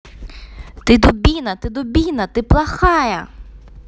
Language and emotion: Russian, angry